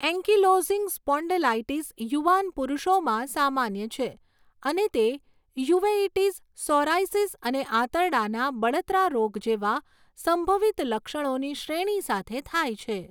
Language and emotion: Gujarati, neutral